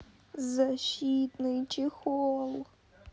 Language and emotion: Russian, sad